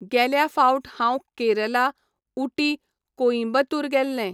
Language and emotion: Goan Konkani, neutral